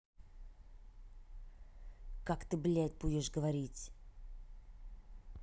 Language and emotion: Russian, angry